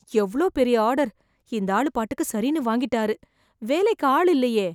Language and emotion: Tamil, fearful